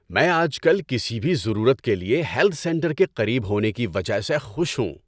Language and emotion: Urdu, happy